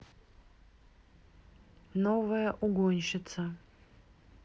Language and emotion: Russian, neutral